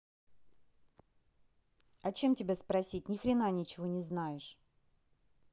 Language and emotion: Russian, angry